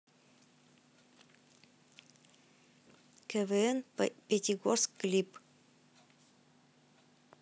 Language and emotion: Russian, neutral